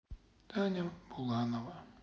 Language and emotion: Russian, sad